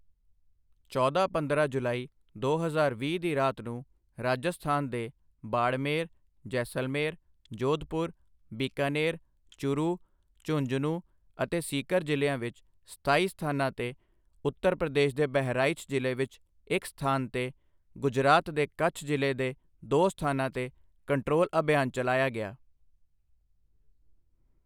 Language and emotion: Punjabi, neutral